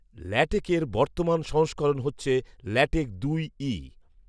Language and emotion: Bengali, neutral